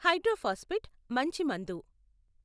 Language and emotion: Telugu, neutral